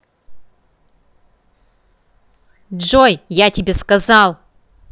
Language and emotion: Russian, angry